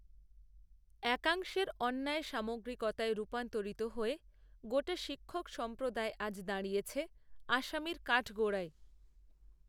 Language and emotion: Bengali, neutral